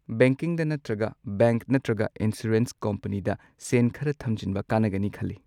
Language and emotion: Manipuri, neutral